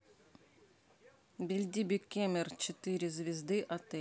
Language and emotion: Russian, neutral